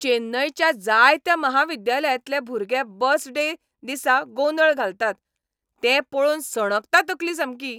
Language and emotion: Goan Konkani, angry